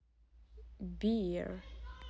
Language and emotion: Russian, neutral